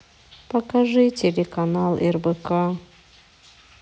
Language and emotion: Russian, sad